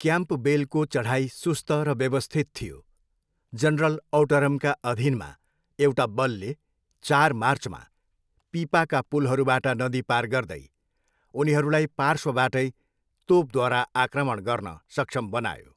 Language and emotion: Nepali, neutral